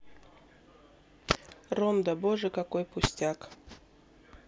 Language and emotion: Russian, neutral